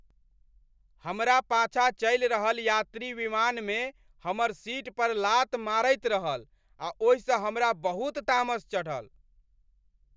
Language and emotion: Maithili, angry